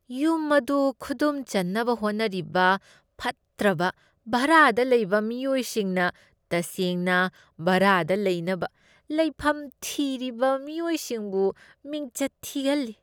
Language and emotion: Manipuri, disgusted